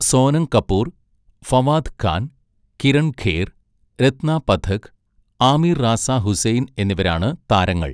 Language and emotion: Malayalam, neutral